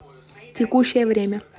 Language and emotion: Russian, neutral